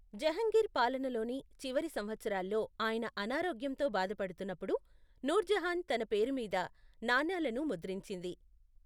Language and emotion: Telugu, neutral